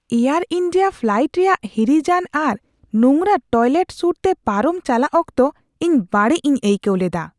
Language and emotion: Santali, disgusted